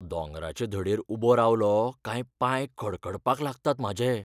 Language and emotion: Goan Konkani, fearful